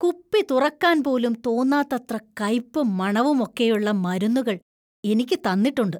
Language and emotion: Malayalam, disgusted